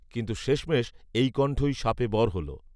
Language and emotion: Bengali, neutral